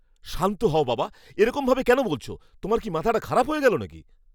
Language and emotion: Bengali, angry